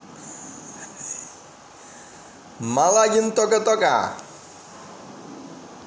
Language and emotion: Russian, positive